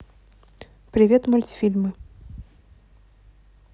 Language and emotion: Russian, neutral